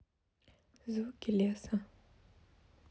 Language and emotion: Russian, neutral